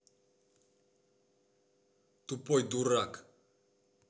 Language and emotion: Russian, angry